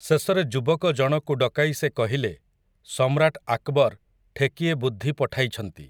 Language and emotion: Odia, neutral